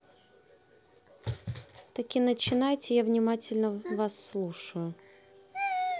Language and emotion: Russian, neutral